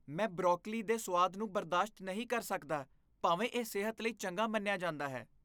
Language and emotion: Punjabi, disgusted